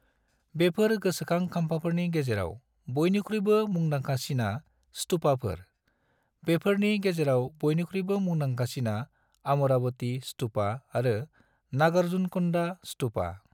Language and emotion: Bodo, neutral